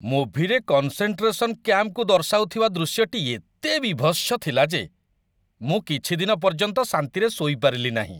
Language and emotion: Odia, disgusted